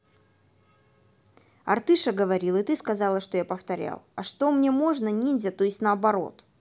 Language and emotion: Russian, neutral